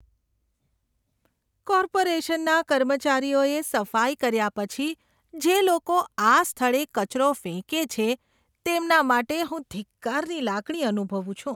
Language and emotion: Gujarati, disgusted